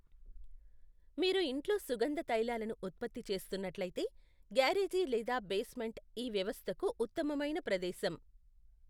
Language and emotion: Telugu, neutral